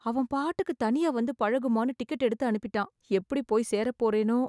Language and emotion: Tamil, fearful